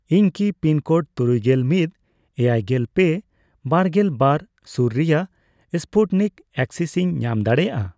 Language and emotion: Santali, neutral